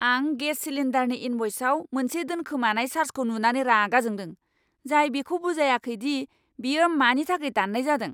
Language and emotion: Bodo, angry